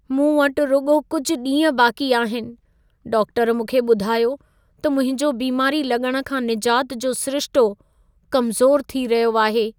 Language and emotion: Sindhi, sad